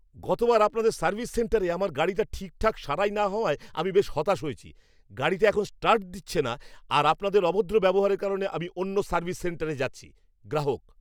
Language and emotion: Bengali, angry